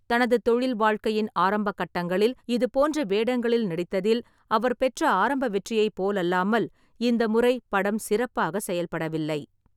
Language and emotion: Tamil, neutral